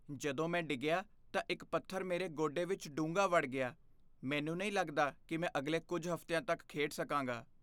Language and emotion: Punjabi, fearful